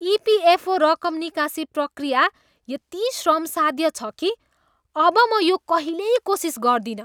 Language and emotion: Nepali, disgusted